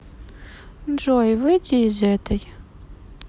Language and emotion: Russian, sad